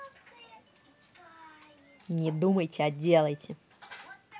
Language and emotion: Russian, angry